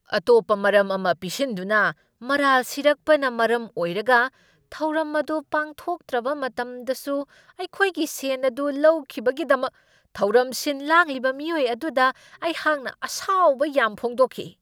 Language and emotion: Manipuri, angry